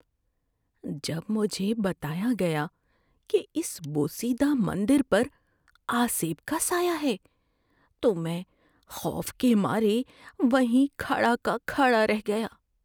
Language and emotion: Urdu, fearful